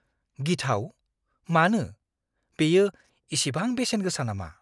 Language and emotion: Bodo, fearful